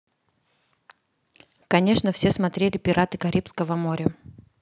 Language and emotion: Russian, neutral